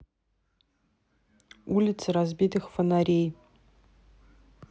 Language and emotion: Russian, neutral